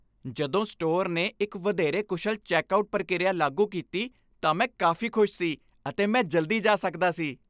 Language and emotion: Punjabi, happy